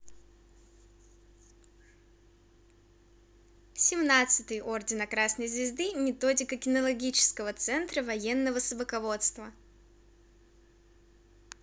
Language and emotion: Russian, positive